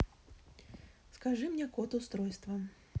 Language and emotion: Russian, neutral